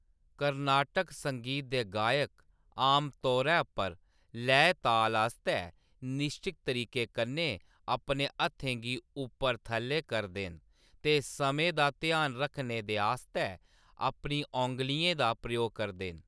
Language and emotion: Dogri, neutral